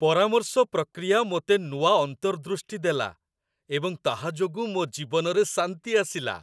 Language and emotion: Odia, happy